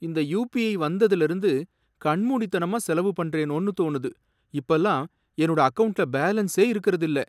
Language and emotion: Tamil, sad